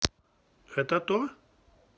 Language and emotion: Russian, neutral